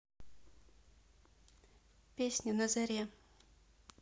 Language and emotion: Russian, neutral